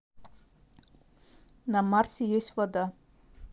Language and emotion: Russian, neutral